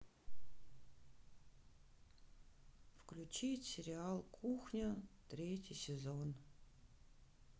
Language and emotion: Russian, sad